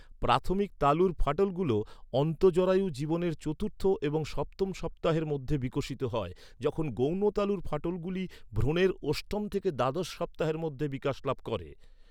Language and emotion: Bengali, neutral